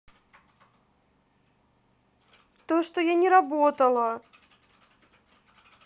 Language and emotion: Russian, sad